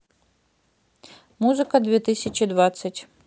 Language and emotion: Russian, neutral